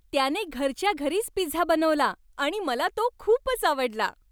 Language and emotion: Marathi, happy